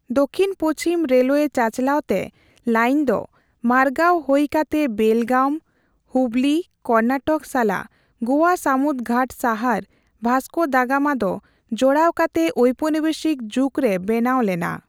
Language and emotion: Santali, neutral